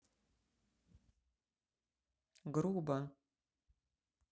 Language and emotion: Russian, neutral